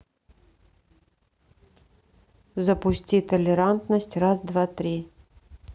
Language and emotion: Russian, neutral